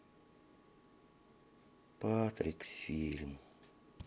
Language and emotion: Russian, sad